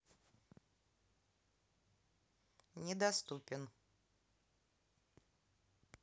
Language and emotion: Russian, neutral